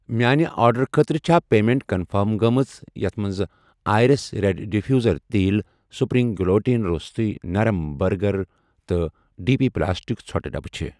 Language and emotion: Kashmiri, neutral